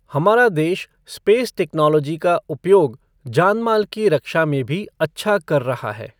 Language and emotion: Hindi, neutral